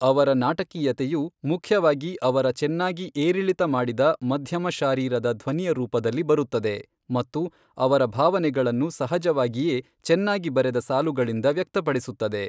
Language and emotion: Kannada, neutral